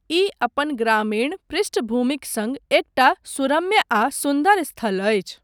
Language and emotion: Maithili, neutral